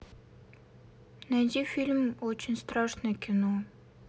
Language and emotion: Russian, sad